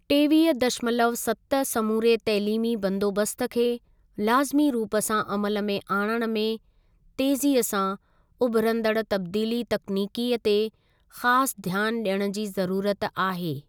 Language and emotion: Sindhi, neutral